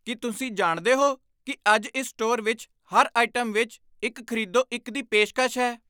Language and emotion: Punjabi, surprised